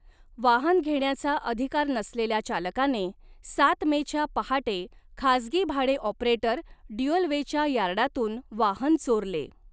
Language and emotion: Marathi, neutral